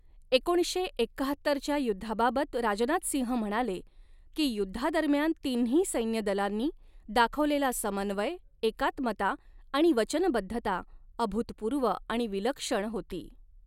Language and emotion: Marathi, neutral